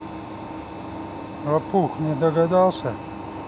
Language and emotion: Russian, neutral